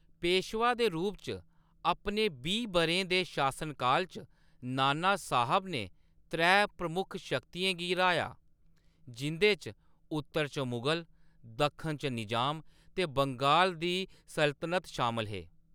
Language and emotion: Dogri, neutral